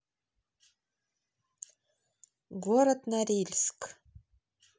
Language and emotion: Russian, neutral